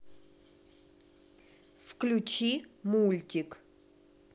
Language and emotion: Russian, neutral